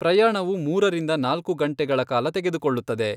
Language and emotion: Kannada, neutral